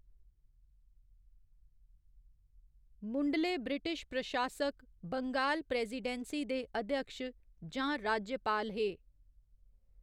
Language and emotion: Dogri, neutral